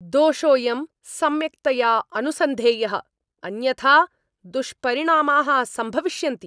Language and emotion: Sanskrit, angry